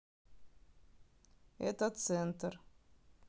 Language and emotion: Russian, neutral